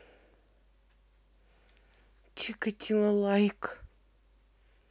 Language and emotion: Russian, neutral